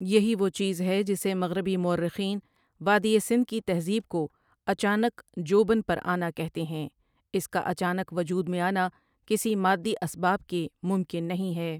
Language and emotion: Urdu, neutral